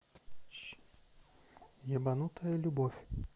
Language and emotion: Russian, neutral